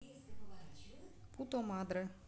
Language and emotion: Russian, neutral